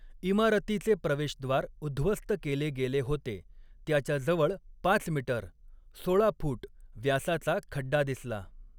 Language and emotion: Marathi, neutral